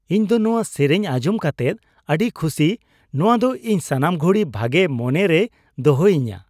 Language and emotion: Santali, happy